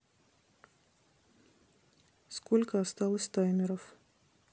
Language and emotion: Russian, neutral